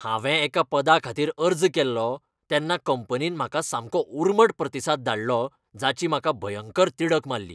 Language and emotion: Goan Konkani, angry